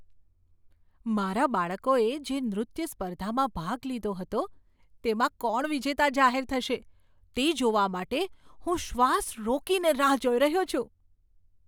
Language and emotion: Gujarati, surprised